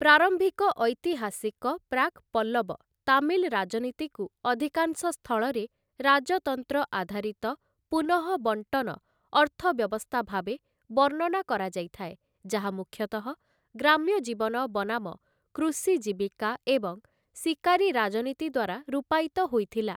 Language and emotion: Odia, neutral